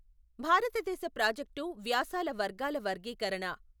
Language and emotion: Telugu, neutral